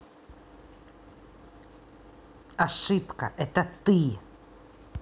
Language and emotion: Russian, angry